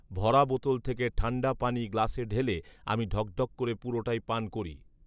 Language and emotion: Bengali, neutral